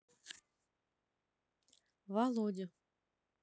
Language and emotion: Russian, neutral